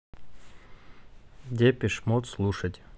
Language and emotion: Russian, neutral